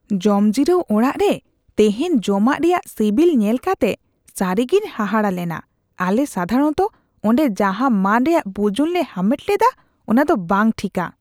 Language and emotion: Santali, disgusted